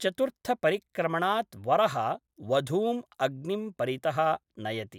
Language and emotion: Sanskrit, neutral